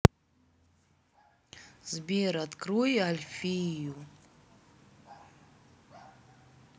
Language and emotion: Russian, neutral